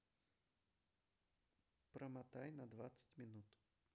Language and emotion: Russian, neutral